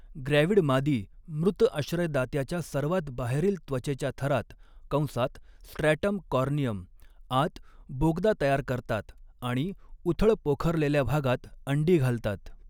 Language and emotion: Marathi, neutral